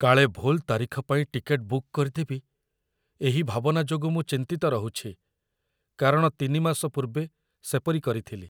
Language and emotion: Odia, fearful